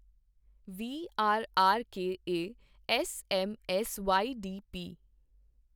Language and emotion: Punjabi, neutral